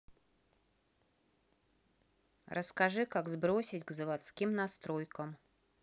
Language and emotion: Russian, neutral